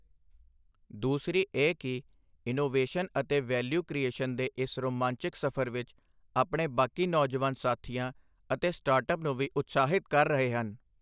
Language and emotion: Punjabi, neutral